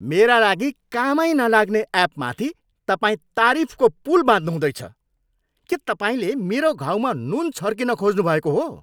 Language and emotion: Nepali, angry